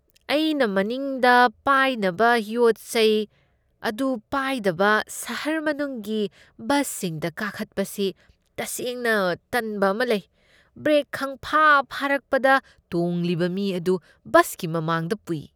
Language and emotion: Manipuri, disgusted